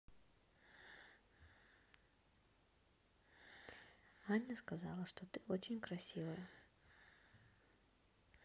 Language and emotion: Russian, neutral